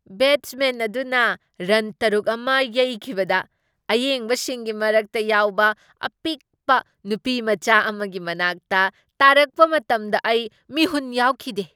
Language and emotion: Manipuri, surprised